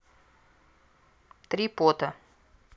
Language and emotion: Russian, neutral